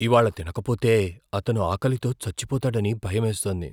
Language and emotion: Telugu, fearful